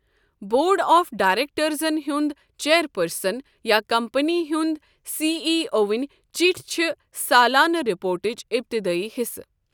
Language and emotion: Kashmiri, neutral